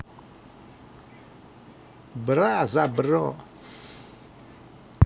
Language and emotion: Russian, positive